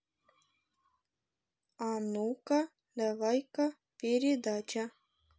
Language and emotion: Russian, neutral